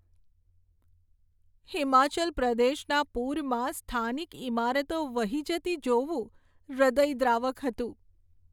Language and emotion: Gujarati, sad